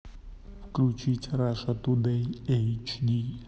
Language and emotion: Russian, neutral